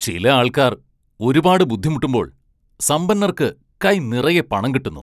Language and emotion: Malayalam, angry